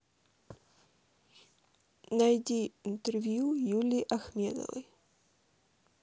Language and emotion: Russian, neutral